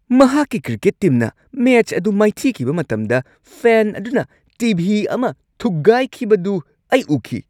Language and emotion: Manipuri, angry